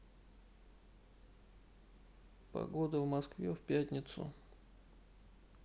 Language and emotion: Russian, neutral